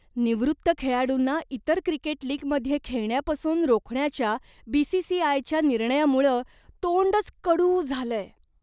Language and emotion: Marathi, disgusted